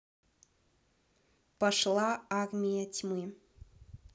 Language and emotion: Russian, neutral